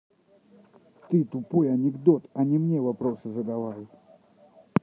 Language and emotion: Russian, angry